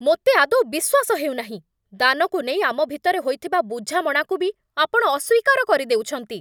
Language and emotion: Odia, angry